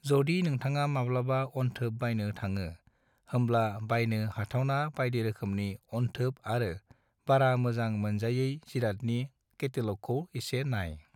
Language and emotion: Bodo, neutral